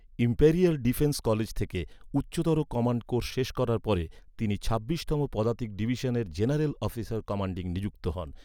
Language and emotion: Bengali, neutral